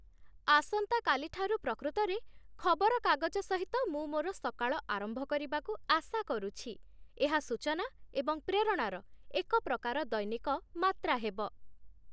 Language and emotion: Odia, happy